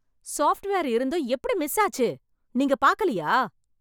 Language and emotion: Tamil, angry